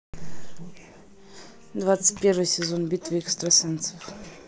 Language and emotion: Russian, neutral